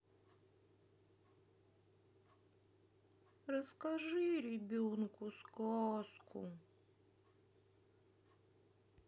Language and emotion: Russian, sad